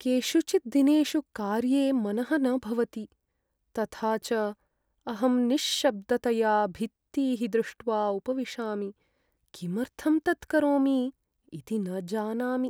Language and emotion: Sanskrit, sad